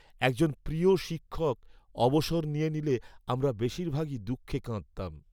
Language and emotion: Bengali, sad